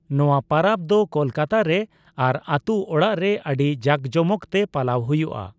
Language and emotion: Santali, neutral